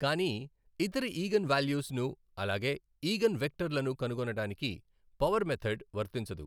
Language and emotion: Telugu, neutral